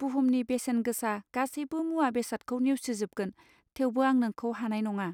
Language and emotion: Bodo, neutral